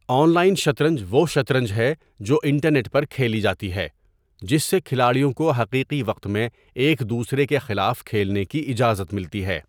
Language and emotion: Urdu, neutral